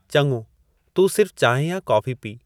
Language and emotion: Sindhi, neutral